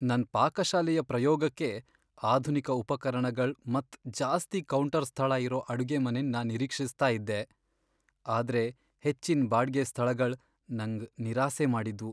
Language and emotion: Kannada, sad